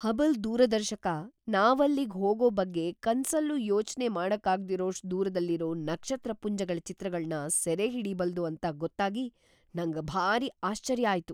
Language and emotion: Kannada, surprised